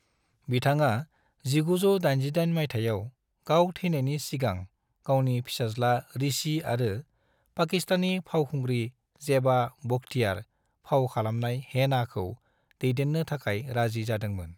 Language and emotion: Bodo, neutral